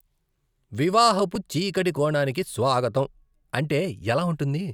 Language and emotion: Telugu, disgusted